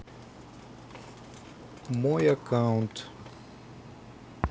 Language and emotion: Russian, neutral